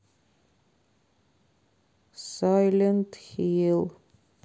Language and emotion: Russian, sad